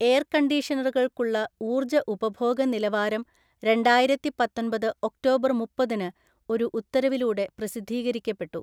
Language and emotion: Malayalam, neutral